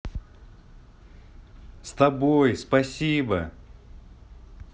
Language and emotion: Russian, positive